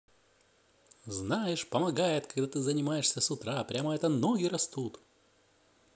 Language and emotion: Russian, positive